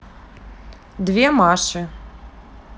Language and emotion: Russian, neutral